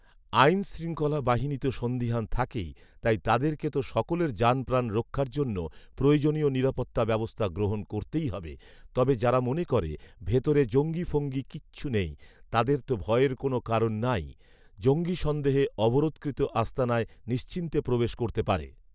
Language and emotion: Bengali, neutral